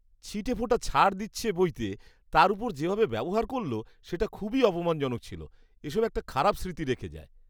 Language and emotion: Bengali, disgusted